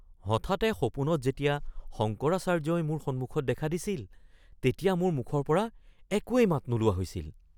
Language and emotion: Assamese, surprised